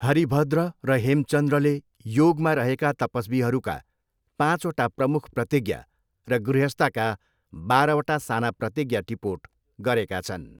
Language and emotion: Nepali, neutral